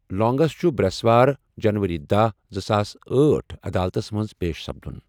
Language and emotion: Kashmiri, neutral